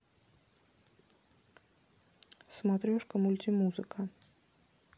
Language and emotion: Russian, neutral